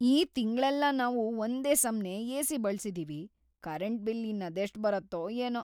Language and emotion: Kannada, fearful